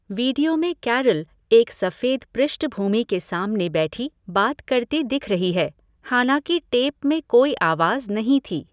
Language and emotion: Hindi, neutral